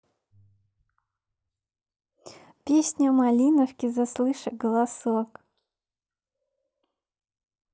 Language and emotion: Russian, positive